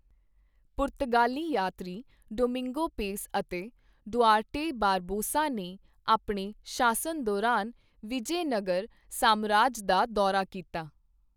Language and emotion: Punjabi, neutral